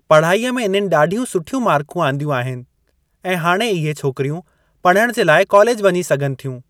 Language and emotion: Sindhi, neutral